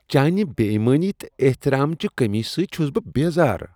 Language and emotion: Kashmiri, disgusted